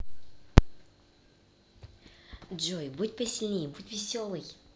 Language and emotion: Russian, positive